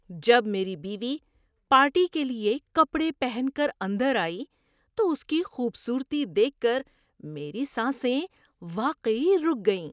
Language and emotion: Urdu, surprised